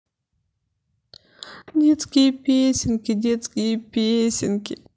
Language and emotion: Russian, sad